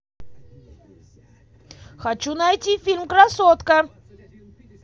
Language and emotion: Russian, positive